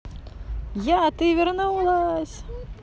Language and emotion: Russian, positive